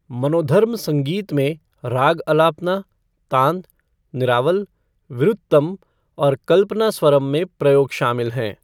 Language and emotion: Hindi, neutral